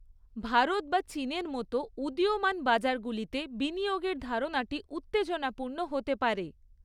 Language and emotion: Bengali, neutral